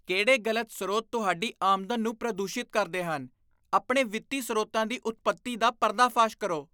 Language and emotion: Punjabi, disgusted